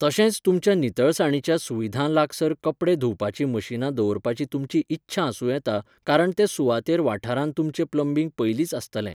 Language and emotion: Goan Konkani, neutral